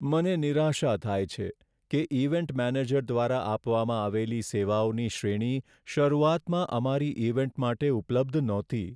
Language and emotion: Gujarati, sad